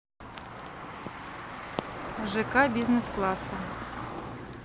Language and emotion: Russian, neutral